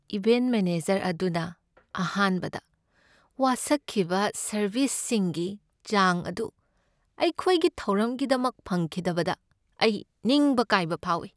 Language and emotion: Manipuri, sad